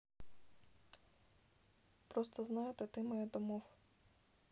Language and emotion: Russian, sad